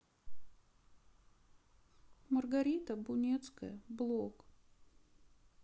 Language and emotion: Russian, sad